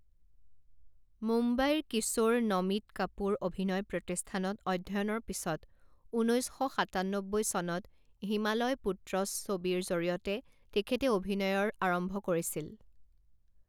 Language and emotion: Assamese, neutral